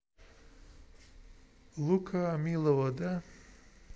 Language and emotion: Russian, neutral